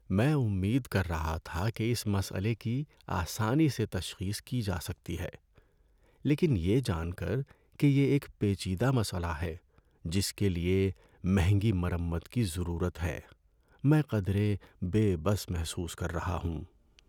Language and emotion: Urdu, sad